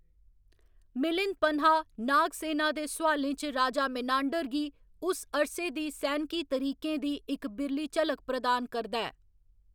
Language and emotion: Dogri, neutral